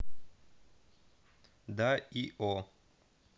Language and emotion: Russian, neutral